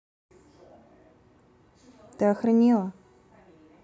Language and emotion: Russian, angry